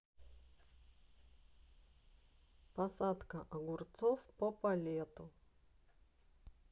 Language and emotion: Russian, neutral